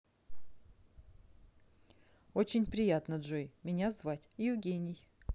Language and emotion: Russian, neutral